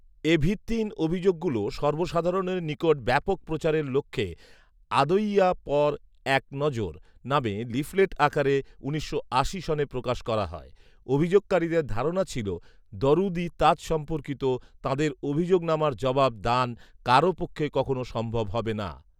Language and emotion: Bengali, neutral